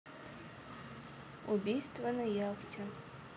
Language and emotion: Russian, neutral